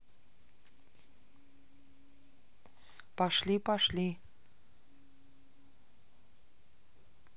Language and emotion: Russian, neutral